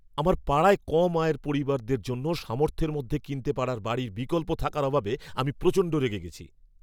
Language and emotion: Bengali, angry